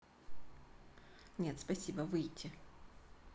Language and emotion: Russian, neutral